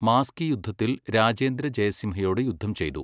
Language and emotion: Malayalam, neutral